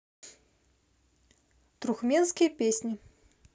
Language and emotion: Russian, neutral